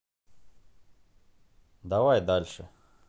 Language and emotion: Russian, neutral